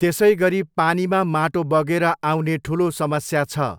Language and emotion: Nepali, neutral